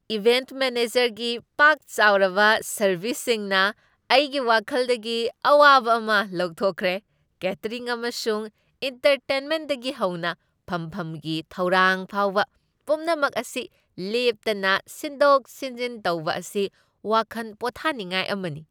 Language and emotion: Manipuri, happy